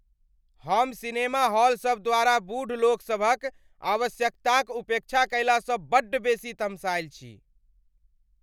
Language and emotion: Maithili, angry